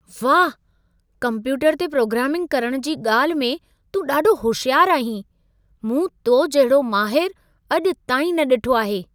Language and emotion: Sindhi, surprised